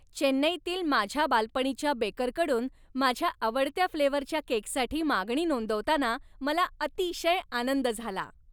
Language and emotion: Marathi, happy